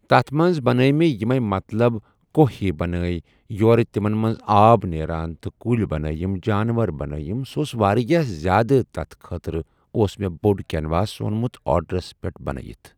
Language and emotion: Kashmiri, neutral